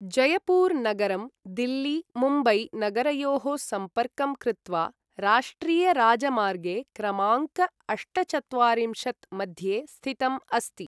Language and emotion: Sanskrit, neutral